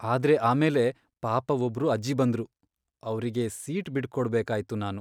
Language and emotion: Kannada, sad